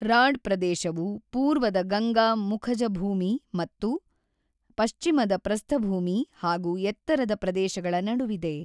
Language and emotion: Kannada, neutral